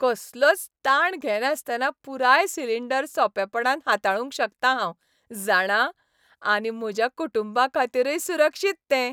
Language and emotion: Goan Konkani, happy